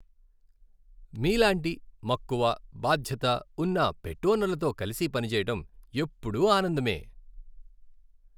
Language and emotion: Telugu, happy